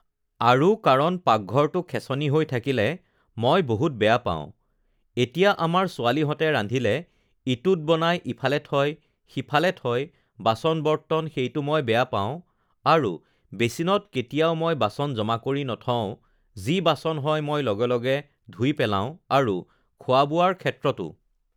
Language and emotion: Assamese, neutral